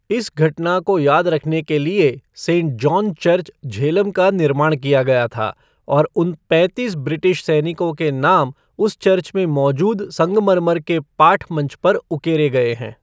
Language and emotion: Hindi, neutral